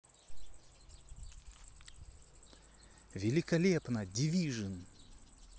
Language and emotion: Russian, positive